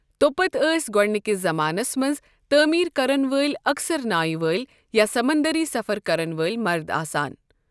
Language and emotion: Kashmiri, neutral